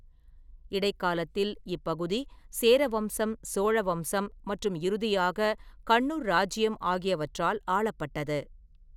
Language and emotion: Tamil, neutral